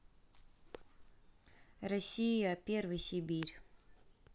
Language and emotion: Russian, neutral